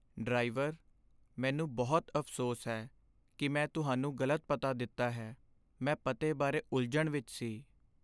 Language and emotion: Punjabi, sad